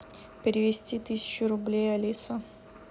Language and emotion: Russian, neutral